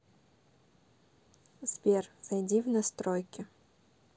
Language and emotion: Russian, neutral